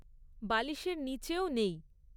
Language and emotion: Bengali, neutral